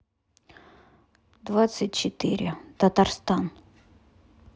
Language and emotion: Russian, neutral